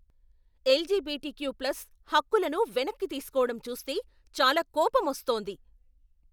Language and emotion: Telugu, angry